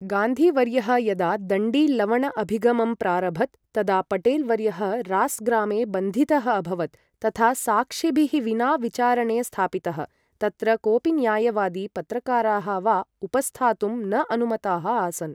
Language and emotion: Sanskrit, neutral